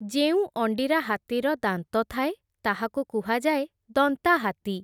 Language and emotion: Odia, neutral